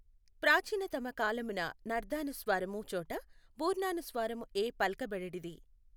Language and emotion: Telugu, neutral